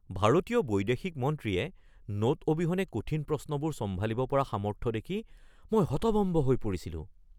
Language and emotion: Assamese, surprised